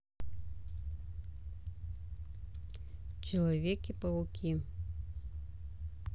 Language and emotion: Russian, neutral